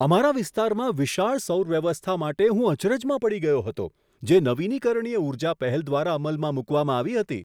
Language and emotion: Gujarati, surprised